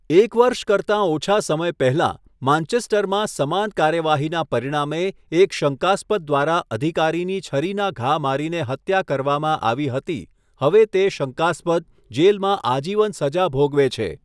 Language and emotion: Gujarati, neutral